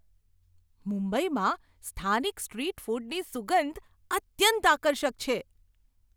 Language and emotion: Gujarati, surprised